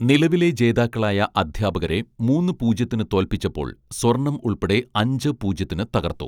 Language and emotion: Malayalam, neutral